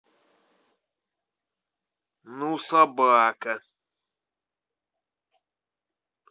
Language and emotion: Russian, angry